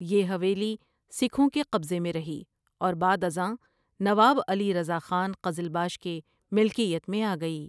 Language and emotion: Urdu, neutral